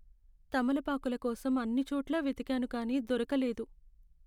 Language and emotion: Telugu, sad